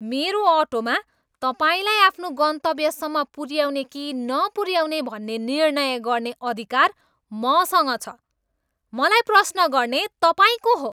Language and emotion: Nepali, angry